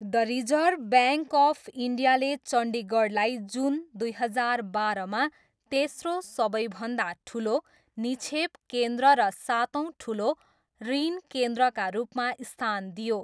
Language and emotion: Nepali, neutral